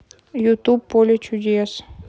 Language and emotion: Russian, neutral